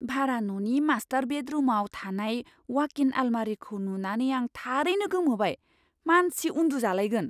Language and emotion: Bodo, surprised